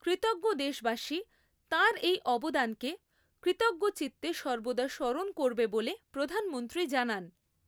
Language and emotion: Bengali, neutral